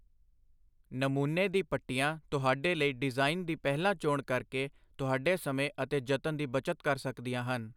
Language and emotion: Punjabi, neutral